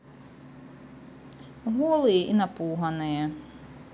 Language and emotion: Russian, neutral